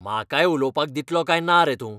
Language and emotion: Goan Konkani, angry